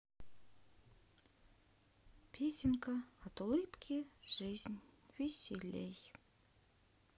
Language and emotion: Russian, sad